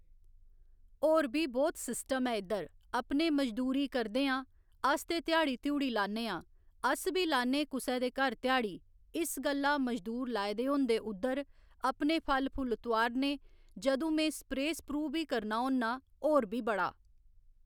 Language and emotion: Dogri, neutral